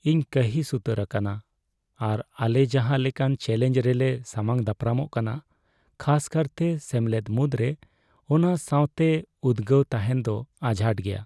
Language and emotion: Santali, sad